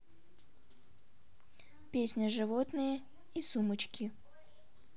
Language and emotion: Russian, neutral